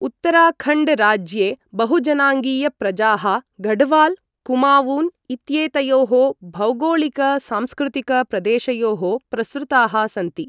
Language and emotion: Sanskrit, neutral